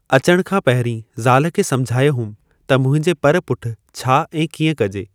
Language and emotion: Sindhi, neutral